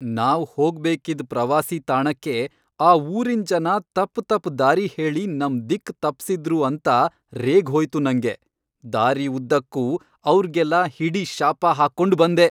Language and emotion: Kannada, angry